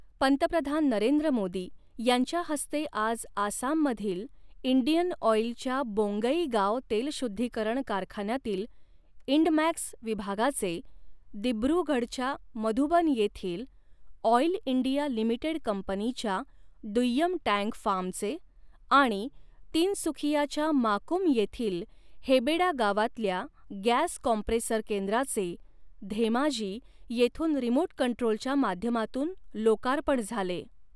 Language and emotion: Marathi, neutral